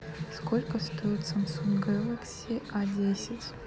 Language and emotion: Russian, neutral